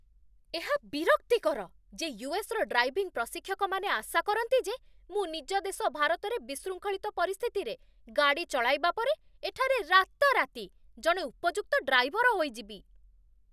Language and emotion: Odia, angry